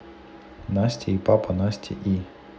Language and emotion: Russian, neutral